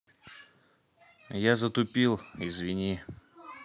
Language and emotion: Russian, neutral